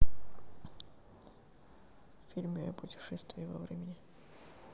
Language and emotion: Russian, neutral